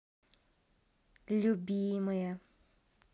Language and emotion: Russian, positive